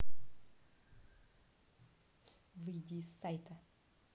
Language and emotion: Russian, angry